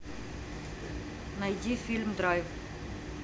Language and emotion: Russian, neutral